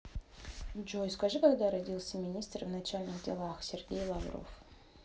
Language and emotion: Russian, neutral